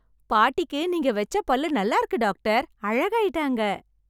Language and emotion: Tamil, happy